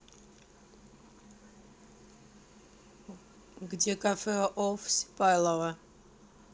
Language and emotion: Russian, neutral